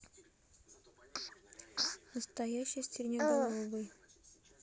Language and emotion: Russian, neutral